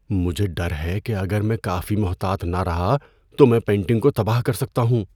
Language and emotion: Urdu, fearful